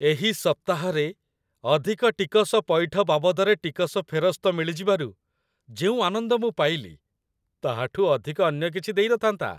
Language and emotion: Odia, happy